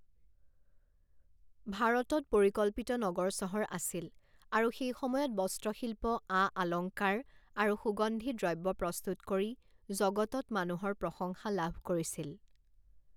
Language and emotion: Assamese, neutral